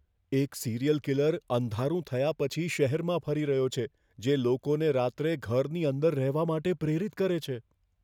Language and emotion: Gujarati, fearful